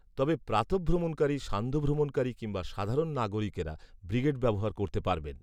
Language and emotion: Bengali, neutral